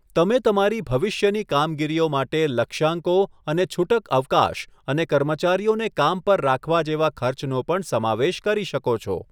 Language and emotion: Gujarati, neutral